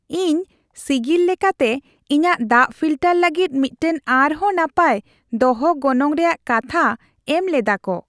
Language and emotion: Santali, happy